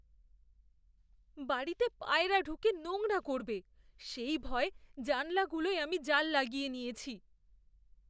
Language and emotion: Bengali, fearful